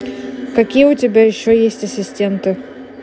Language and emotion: Russian, neutral